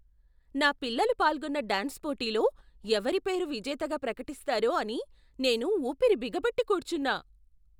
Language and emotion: Telugu, surprised